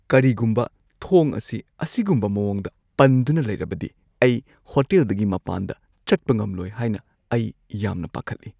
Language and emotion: Manipuri, fearful